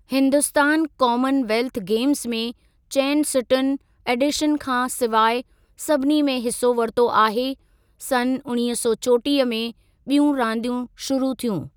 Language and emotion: Sindhi, neutral